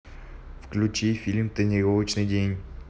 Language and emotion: Russian, neutral